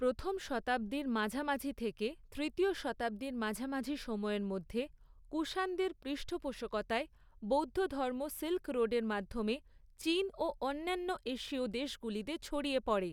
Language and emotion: Bengali, neutral